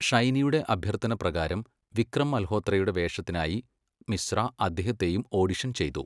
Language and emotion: Malayalam, neutral